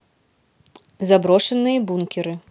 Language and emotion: Russian, neutral